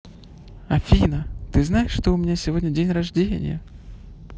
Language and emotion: Russian, positive